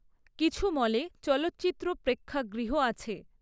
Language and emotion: Bengali, neutral